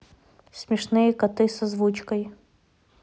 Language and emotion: Russian, neutral